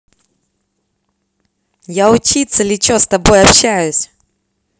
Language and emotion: Russian, positive